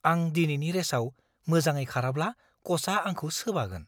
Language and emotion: Bodo, fearful